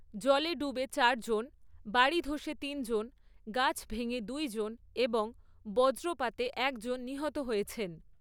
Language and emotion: Bengali, neutral